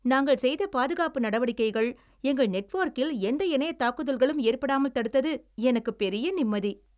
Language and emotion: Tamil, happy